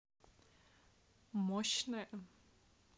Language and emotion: Russian, neutral